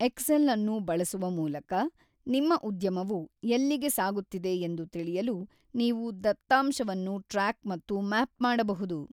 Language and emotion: Kannada, neutral